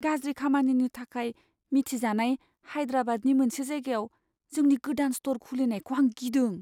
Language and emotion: Bodo, fearful